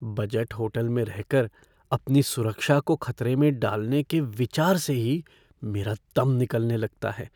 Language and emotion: Hindi, fearful